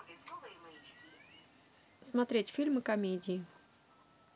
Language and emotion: Russian, neutral